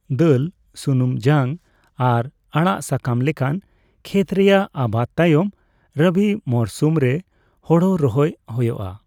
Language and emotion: Santali, neutral